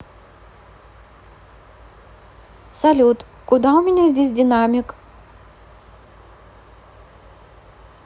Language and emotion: Russian, neutral